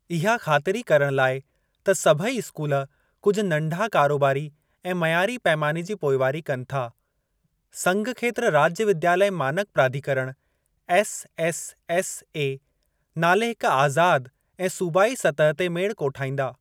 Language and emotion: Sindhi, neutral